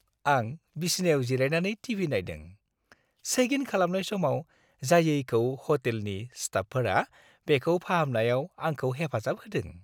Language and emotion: Bodo, happy